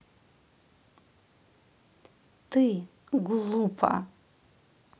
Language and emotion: Russian, angry